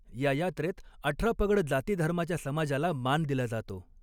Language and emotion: Marathi, neutral